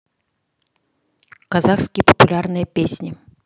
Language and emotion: Russian, neutral